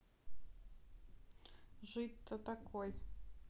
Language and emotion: Russian, neutral